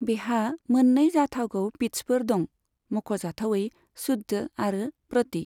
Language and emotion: Bodo, neutral